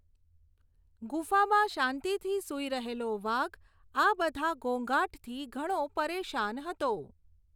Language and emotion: Gujarati, neutral